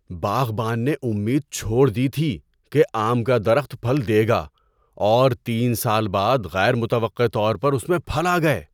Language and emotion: Urdu, surprised